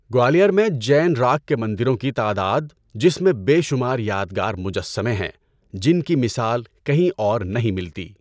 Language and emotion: Urdu, neutral